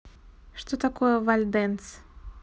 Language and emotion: Russian, neutral